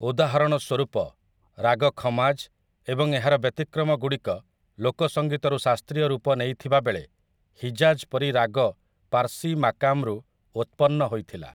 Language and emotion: Odia, neutral